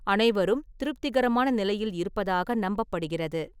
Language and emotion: Tamil, neutral